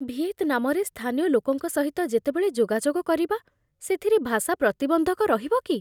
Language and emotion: Odia, fearful